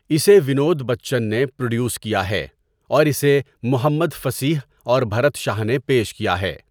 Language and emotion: Urdu, neutral